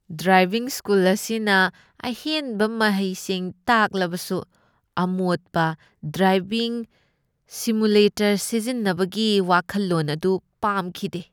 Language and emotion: Manipuri, disgusted